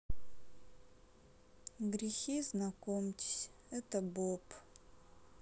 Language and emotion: Russian, sad